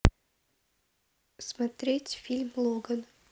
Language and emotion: Russian, neutral